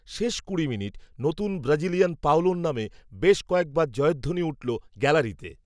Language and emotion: Bengali, neutral